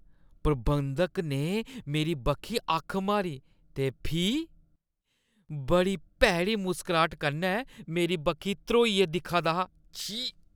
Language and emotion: Dogri, disgusted